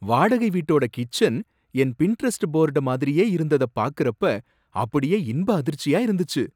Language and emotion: Tamil, surprised